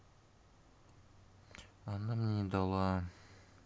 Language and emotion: Russian, sad